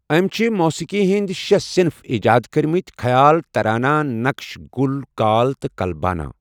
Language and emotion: Kashmiri, neutral